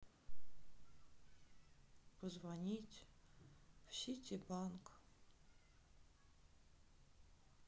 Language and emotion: Russian, sad